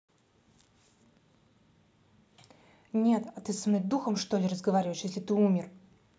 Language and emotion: Russian, angry